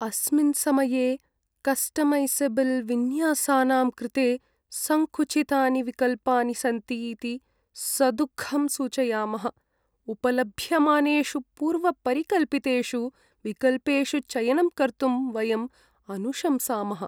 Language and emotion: Sanskrit, sad